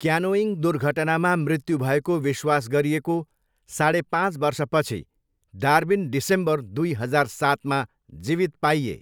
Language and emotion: Nepali, neutral